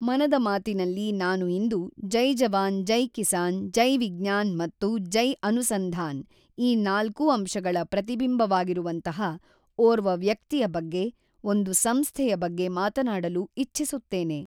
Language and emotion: Kannada, neutral